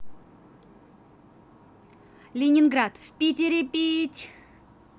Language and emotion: Russian, positive